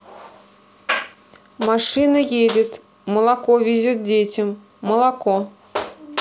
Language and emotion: Russian, neutral